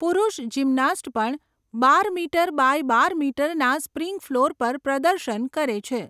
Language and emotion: Gujarati, neutral